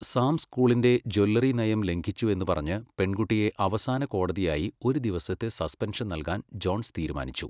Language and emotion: Malayalam, neutral